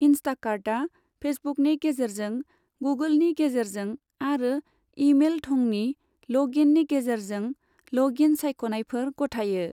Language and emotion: Bodo, neutral